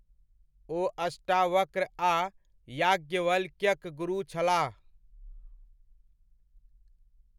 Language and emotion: Maithili, neutral